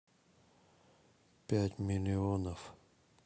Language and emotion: Russian, neutral